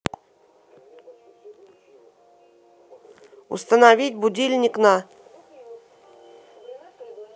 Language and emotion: Russian, neutral